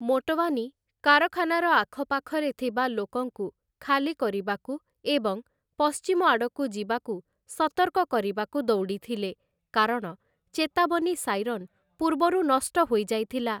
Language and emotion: Odia, neutral